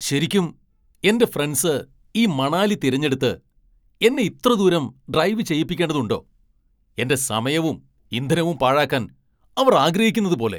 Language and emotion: Malayalam, angry